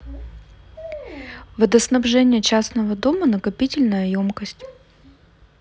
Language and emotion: Russian, neutral